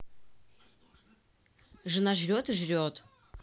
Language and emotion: Russian, neutral